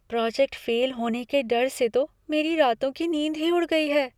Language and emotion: Hindi, fearful